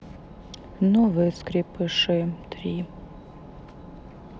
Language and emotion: Russian, sad